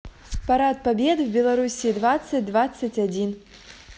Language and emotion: Russian, neutral